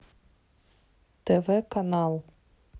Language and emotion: Russian, neutral